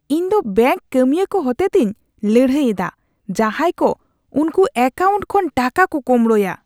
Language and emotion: Santali, disgusted